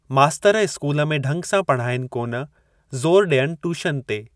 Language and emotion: Sindhi, neutral